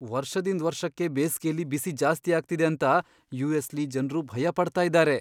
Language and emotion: Kannada, fearful